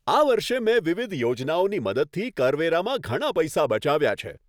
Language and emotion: Gujarati, happy